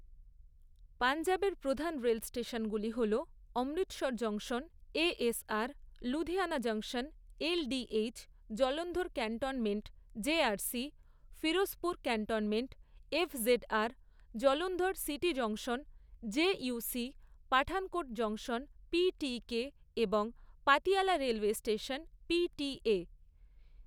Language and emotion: Bengali, neutral